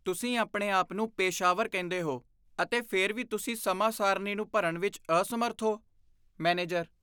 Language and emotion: Punjabi, disgusted